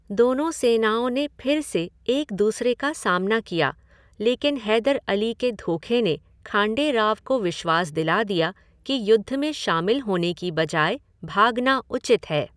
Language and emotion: Hindi, neutral